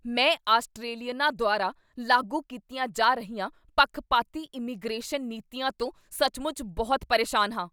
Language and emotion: Punjabi, angry